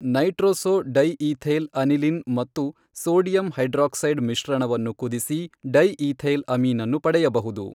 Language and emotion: Kannada, neutral